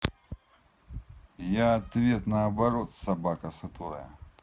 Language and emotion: Russian, angry